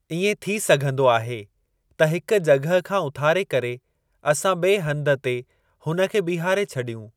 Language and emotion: Sindhi, neutral